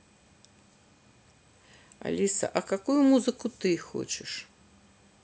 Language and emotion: Russian, neutral